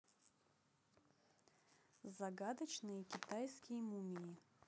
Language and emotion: Russian, neutral